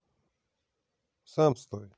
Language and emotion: Russian, neutral